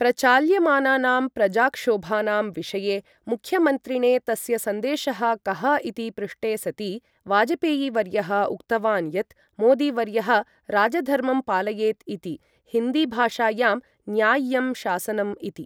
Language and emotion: Sanskrit, neutral